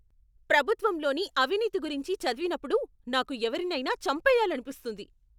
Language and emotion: Telugu, angry